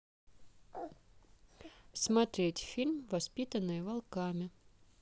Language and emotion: Russian, neutral